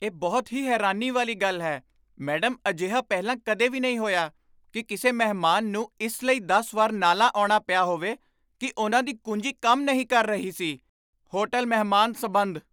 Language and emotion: Punjabi, surprised